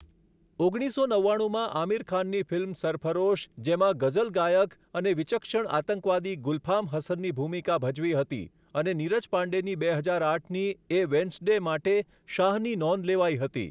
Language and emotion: Gujarati, neutral